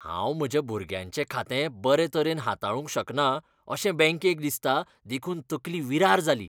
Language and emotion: Goan Konkani, disgusted